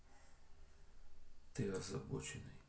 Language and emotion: Russian, neutral